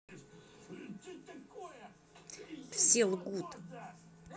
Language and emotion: Russian, angry